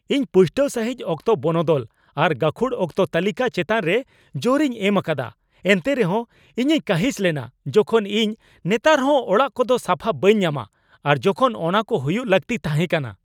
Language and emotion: Santali, angry